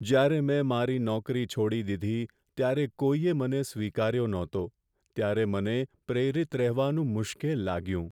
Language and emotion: Gujarati, sad